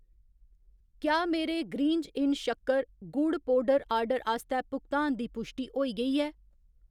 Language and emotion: Dogri, neutral